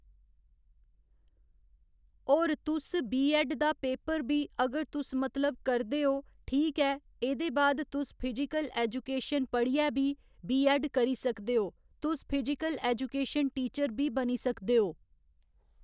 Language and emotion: Dogri, neutral